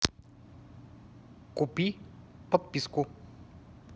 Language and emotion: Russian, neutral